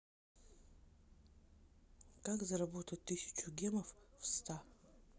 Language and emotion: Russian, neutral